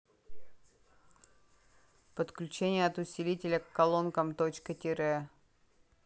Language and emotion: Russian, neutral